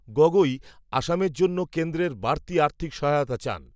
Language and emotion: Bengali, neutral